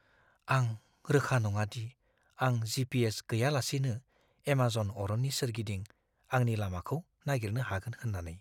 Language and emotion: Bodo, fearful